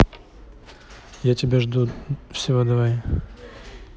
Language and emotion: Russian, neutral